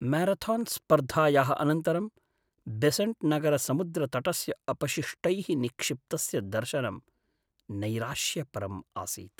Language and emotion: Sanskrit, sad